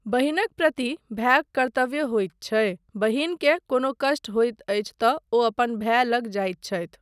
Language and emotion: Maithili, neutral